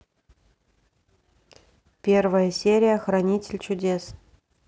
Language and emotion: Russian, neutral